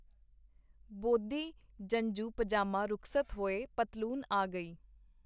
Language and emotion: Punjabi, neutral